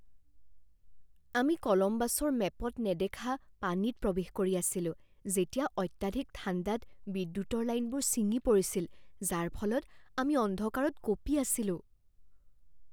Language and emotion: Assamese, fearful